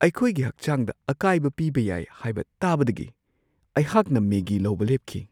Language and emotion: Manipuri, fearful